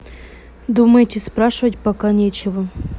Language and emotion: Russian, neutral